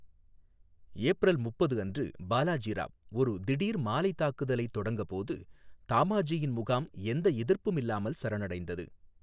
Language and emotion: Tamil, neutral